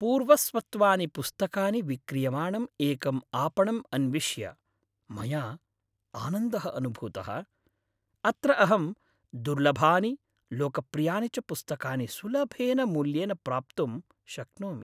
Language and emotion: Sanskrit, happy